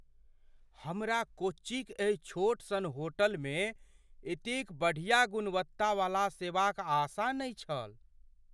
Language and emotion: Maithili, surprised